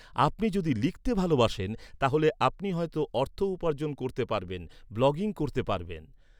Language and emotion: Bengali, neutral